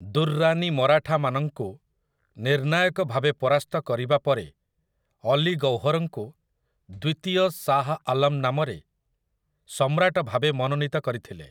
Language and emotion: Odia, neutral